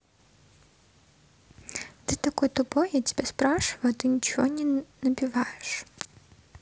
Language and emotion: Russian, neutral